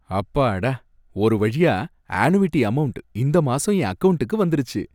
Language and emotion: Tamil, happy